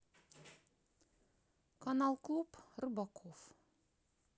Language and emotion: Russian, neutral